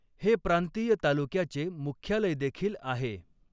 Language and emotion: Marathi, neutral